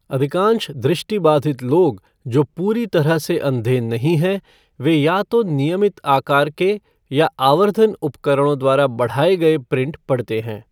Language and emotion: Hindi, neutral